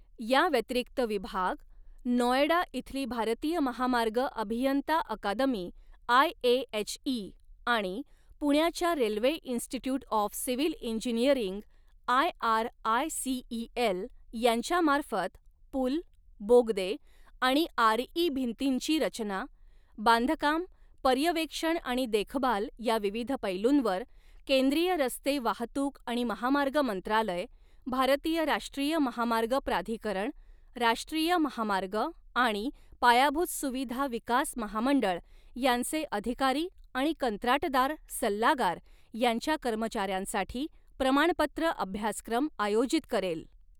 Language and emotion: Marathi, neutral